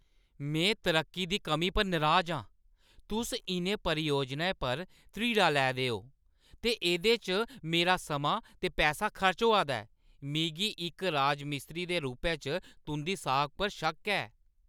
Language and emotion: Dogri, angry